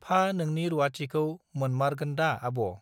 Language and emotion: Bodo, neutral